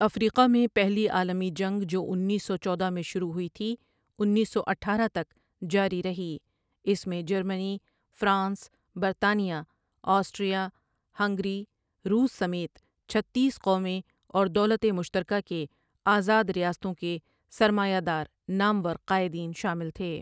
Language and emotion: Urdu, neutral